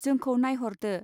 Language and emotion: Bodo, neutral